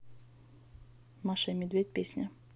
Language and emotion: Russian, neutral